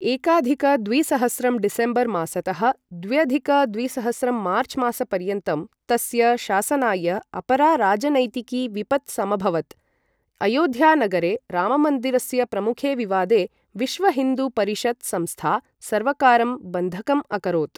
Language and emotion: Sanskrit, neutral